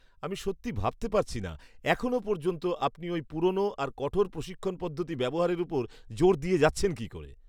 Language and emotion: Bengali, disgusted